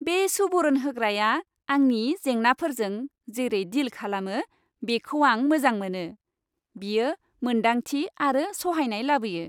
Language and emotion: Bodo, happy